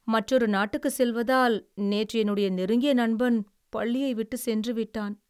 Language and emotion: Tamil, sad